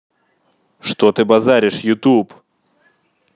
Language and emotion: Russian, angry